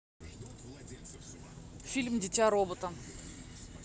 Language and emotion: Russian, neutral